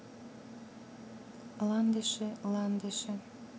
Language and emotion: Russian, neutral